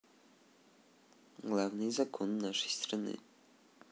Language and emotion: Russian, neutral